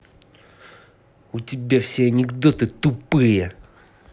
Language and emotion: Russian, angry